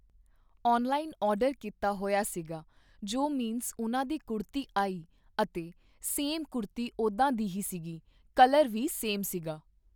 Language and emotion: Punjabi, neutral